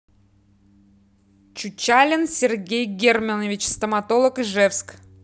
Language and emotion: Russian, neutral